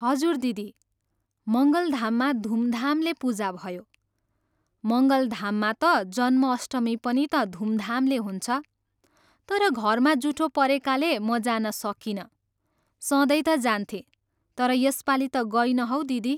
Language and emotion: Nepali, neutral